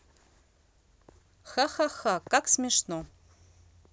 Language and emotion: Russian, neutral